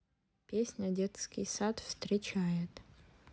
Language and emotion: Russian, neutral